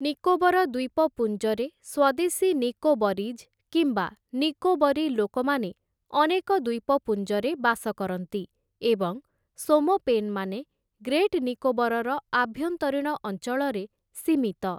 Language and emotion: Odia, neutral